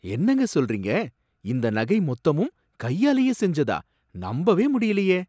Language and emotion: Tamil, surprised